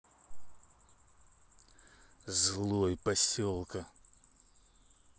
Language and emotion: Russian, angry